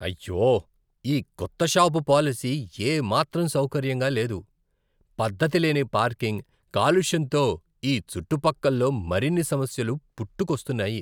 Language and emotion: Telugu, disgusted